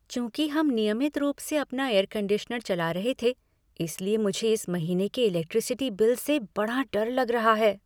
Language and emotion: Hindi, fearful